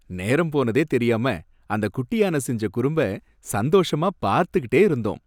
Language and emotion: Tamil, happy